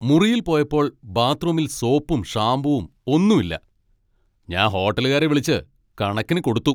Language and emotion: Malayalam, angry